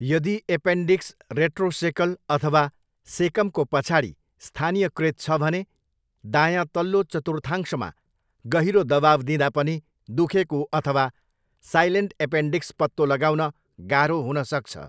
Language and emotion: Nepali, neutral